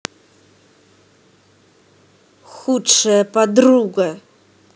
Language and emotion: Russian, angry